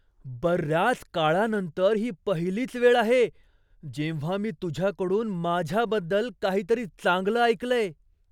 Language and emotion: Marathi, surprised